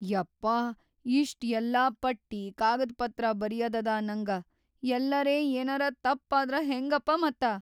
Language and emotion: Kannada, fearful